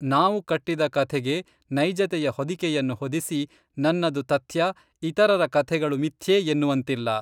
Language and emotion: Kannada, neutral